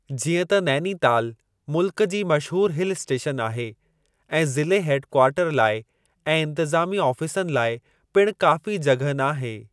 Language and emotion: Sindhi, neutral